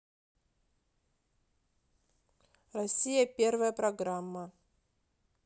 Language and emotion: Russian, neutral